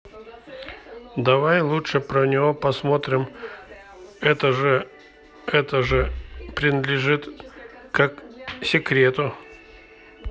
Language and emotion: Russian, neutral